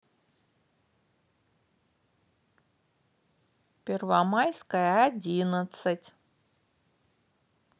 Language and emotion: Russian, positive